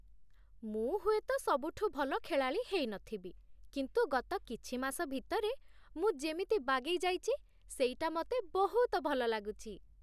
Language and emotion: Odia, happy